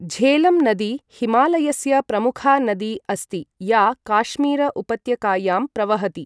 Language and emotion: Sanskrit, neutral